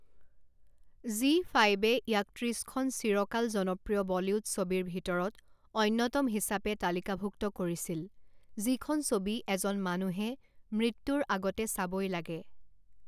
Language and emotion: Assamese, neutral